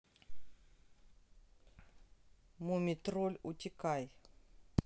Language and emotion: Russian, neutral